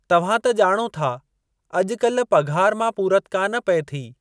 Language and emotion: Sindhi, neutral